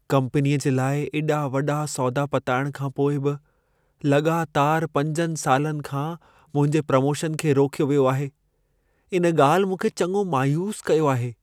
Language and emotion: Sindhi, sad